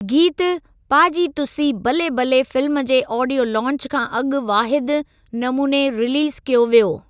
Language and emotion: Sindhi, neutral